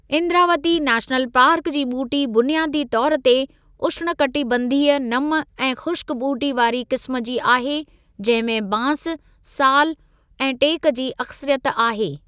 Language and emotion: Sindhi, neutral